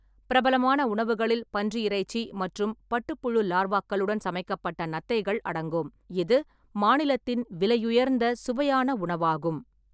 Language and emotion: Tamil, neutral